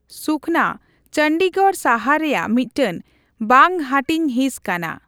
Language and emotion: Santali, neutral